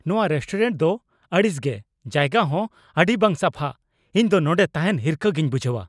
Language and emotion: Santali, angry